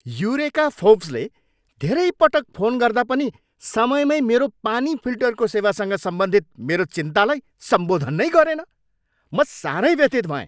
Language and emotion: Nepali, angry